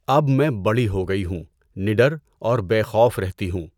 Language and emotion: Urdu, neutral